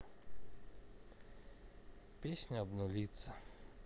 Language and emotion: Russian, sad